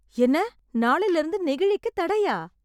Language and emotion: Tamil, surprised